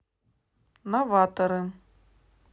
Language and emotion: Russian, neutral